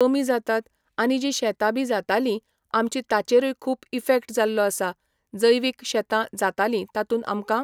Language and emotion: Goan Konkani, neutral